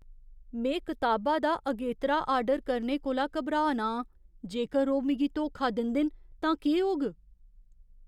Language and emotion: Dogri, fearful